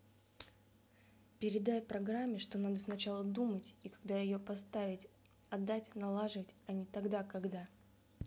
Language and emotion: Russian, angry